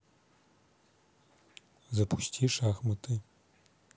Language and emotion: Russian, neutral